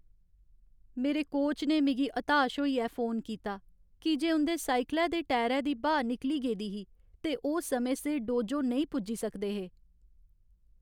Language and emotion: Dogri, sad